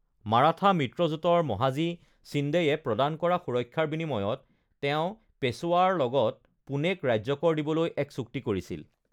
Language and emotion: Assamese, neutral